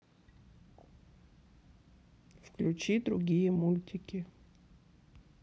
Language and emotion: Russian, sad